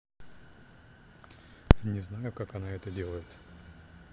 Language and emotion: Russian, neutral